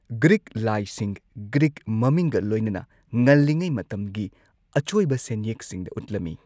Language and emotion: Manipuri, neutral